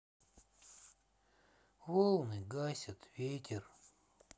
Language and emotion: Russian, sad